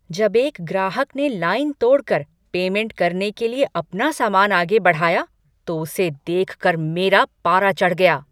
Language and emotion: Hindi, angry